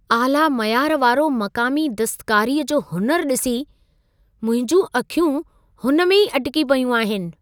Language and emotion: Sindhi, surprised